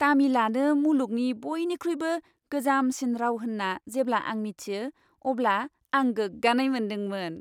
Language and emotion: Bodo, happy